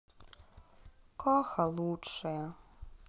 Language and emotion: Russian, sad